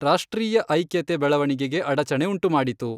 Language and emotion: Kannada, neutral